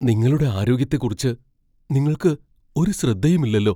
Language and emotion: Malayalam, fearful